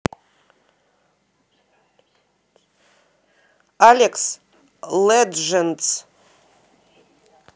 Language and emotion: Russian, neutral